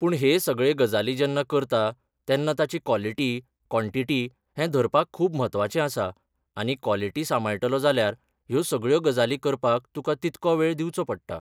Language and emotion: Goan Konkani, neutral